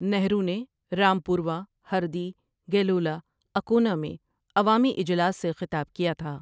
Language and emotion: Urdu, neutral